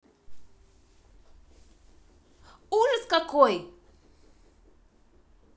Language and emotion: Russian, angry